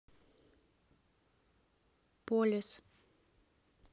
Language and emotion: Russian, neutral